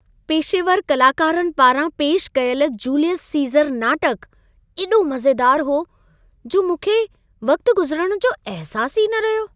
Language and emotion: Sindhi, happy